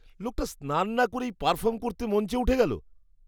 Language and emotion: Bengali, disgusted